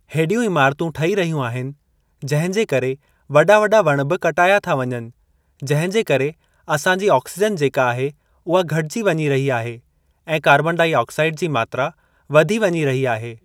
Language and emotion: Sindhi, neutral